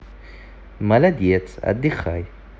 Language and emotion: Russian, positive